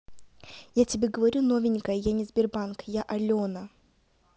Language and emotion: Russian, angry